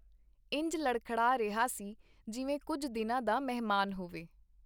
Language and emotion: Punjabi, neutral